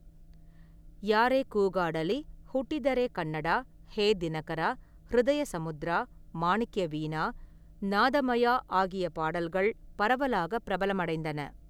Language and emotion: Tamil, neutral